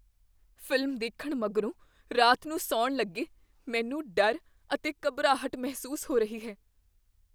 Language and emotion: Punjabi, fearful